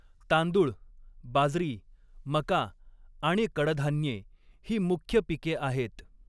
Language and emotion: Marathi, neutral